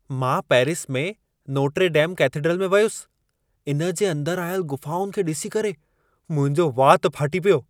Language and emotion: Sindhi, surprised